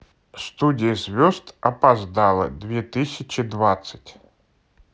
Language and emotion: Russian, neutral